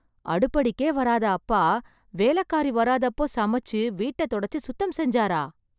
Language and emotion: Tamil, surprised